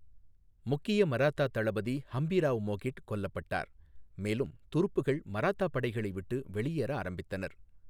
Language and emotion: Tamil, neutral